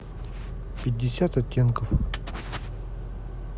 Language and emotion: Russian, neutral